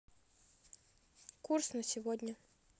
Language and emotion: Russian, neutral